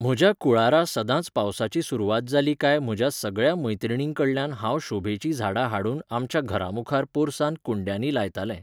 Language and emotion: Goan Konkani, neutral